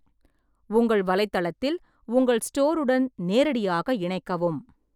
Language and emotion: Tamil, neutral